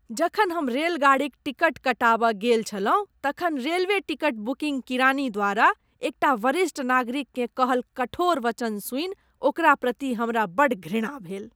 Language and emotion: Maithili, disgusted